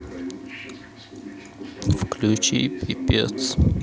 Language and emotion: Russian, sad